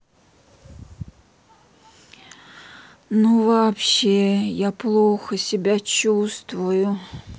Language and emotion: Russian, sad